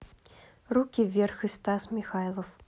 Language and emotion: Russian, neutral